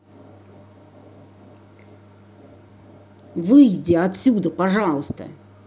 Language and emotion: Russian, angry